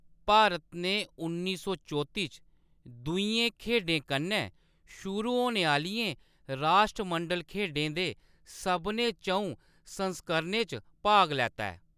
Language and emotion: Dogri, neutral